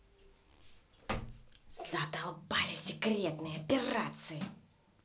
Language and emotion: Russian, angry